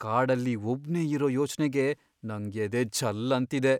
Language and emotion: Kannada, fearful